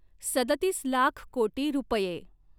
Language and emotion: Marathi, neutral